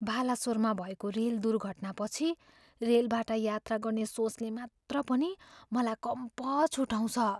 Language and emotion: Nepali, fearful